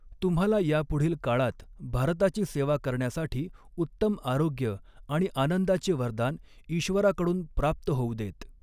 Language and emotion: Marathi, neutral